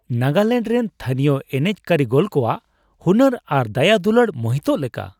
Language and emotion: Santali, surprised